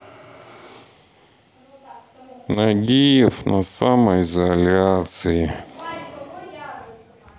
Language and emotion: Russian, sad